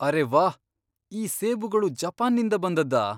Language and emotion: Kannada, surprised